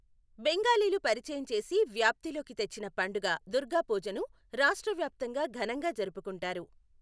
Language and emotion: Telugu, neutral